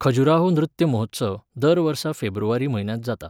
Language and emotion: Goan Konkani, neutral